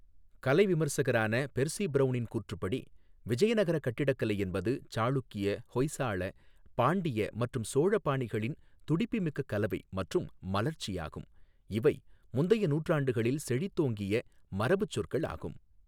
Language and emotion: Tamil, neutral